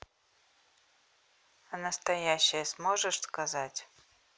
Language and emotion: Russian, neutral